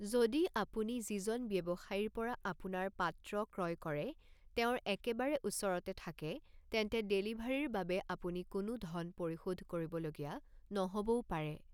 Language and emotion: Assamese, neutral